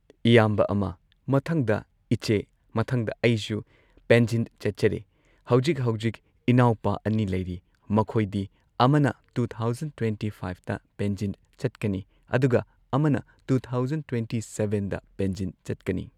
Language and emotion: Manipuri, neutral